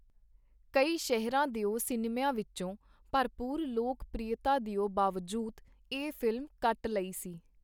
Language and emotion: Punjabi, neutral